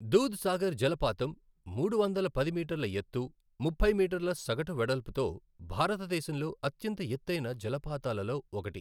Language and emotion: Telugu, neutral